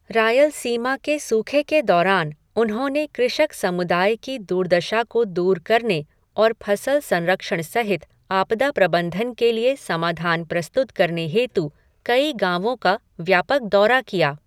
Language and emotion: Hindi, neutral